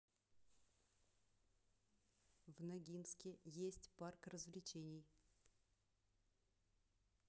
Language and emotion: Russian, neutral